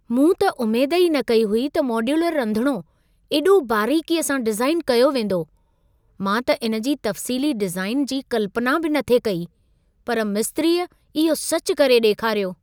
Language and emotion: Sindhi, surprised